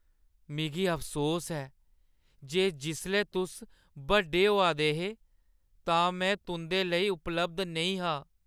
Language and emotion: Dogri, sad